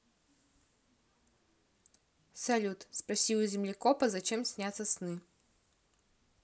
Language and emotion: Russian, neutral